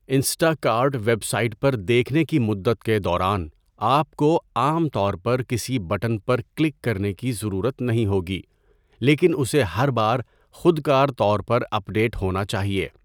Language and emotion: Urdu, neutral